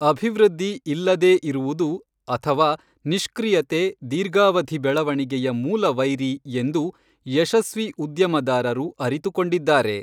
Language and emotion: Kannada, neutral